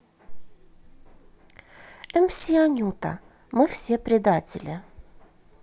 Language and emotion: Russian, neutral